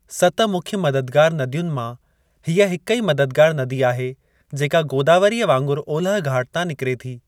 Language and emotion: Sindhi, neutral